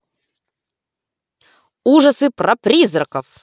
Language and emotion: Russian, positive